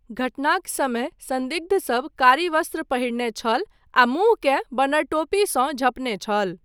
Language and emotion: Maithili, neutral